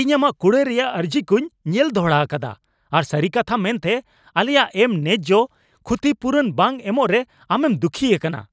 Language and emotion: Santali, angry